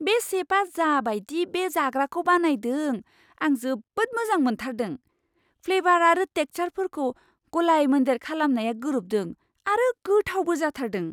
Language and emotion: Bodo, surprised